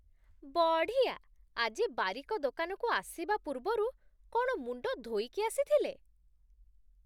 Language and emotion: Odia, surprised